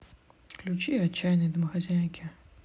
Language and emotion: Russian, neutral